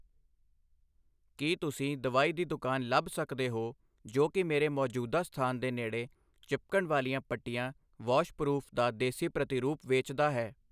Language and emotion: Punjabi, neutral